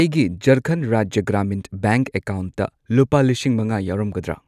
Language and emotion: Manipuri, neutral